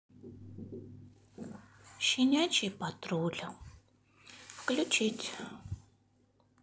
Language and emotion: Russian, sad